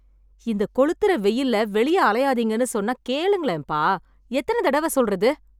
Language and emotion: Tamil, angry